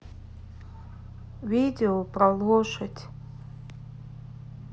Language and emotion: Russian, sad